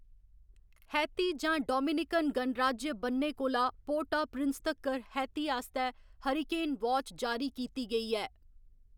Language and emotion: Dogri, neutral